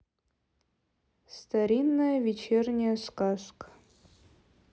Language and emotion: Russian, neutral